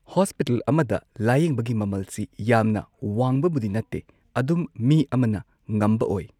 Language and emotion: Manipuri, neutral